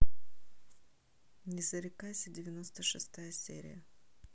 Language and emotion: Russian, neutral